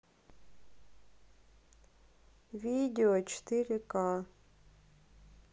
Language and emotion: Russian, neutral